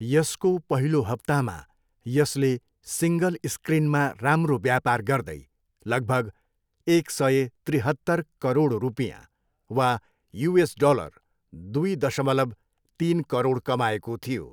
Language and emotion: Nepali, neutral